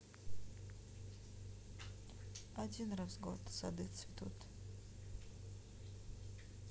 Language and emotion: Russian, sad